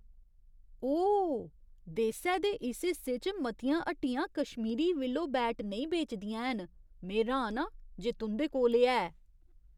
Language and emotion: Dogri, surprised